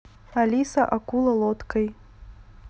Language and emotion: Russian, neutral